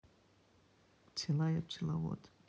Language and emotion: Russian, neutral